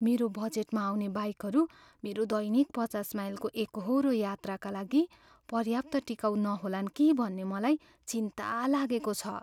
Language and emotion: Nepali, fearful